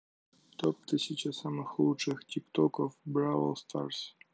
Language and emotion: Russian, neutral